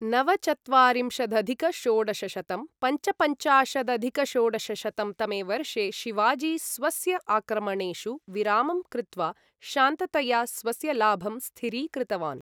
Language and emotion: Sanskrit, neutral